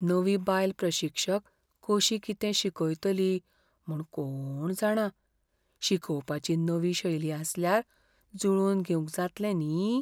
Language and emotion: Goan Konkani, fearful